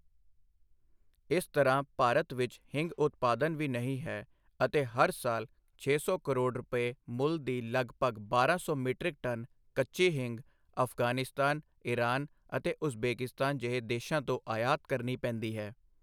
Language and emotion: Punjabi, neutral